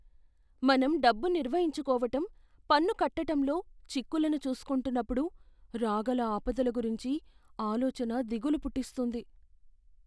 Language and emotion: Telugu, fearful